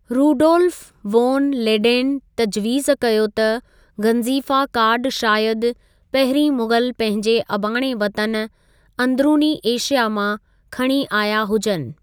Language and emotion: Sindhi, neutral